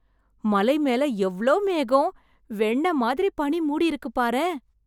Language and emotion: Tamil, surprised